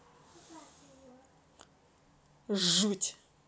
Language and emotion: Russian, angry